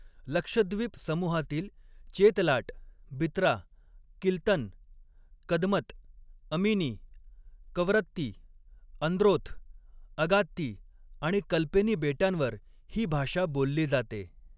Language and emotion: Marathi, neutral